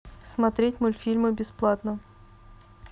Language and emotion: Russian, neutral